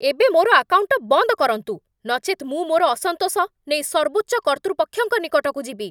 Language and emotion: Odia, angry